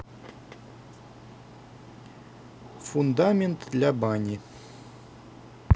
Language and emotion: Russian, neutral